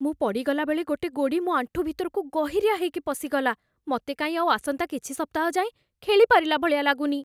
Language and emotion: Odia, fearful